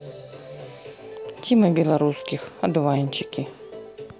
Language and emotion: Russian, neutral